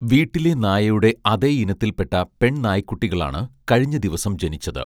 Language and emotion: Malayalam, neutral